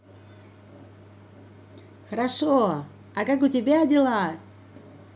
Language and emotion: Russian, positive